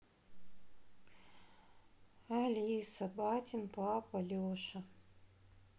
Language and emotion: Russian, sad